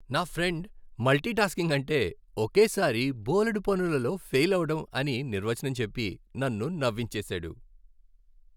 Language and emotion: Telugu, happy